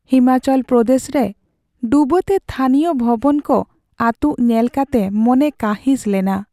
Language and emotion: Santali, sad